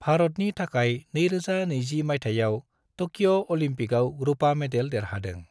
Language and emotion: Bodo, neutral